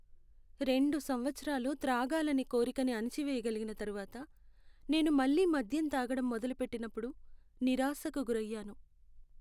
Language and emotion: Telugu, sad